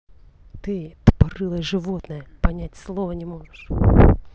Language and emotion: Russian, angry